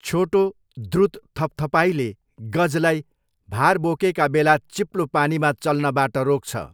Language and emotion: Nepali, neutral